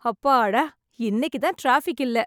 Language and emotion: Tamil, happy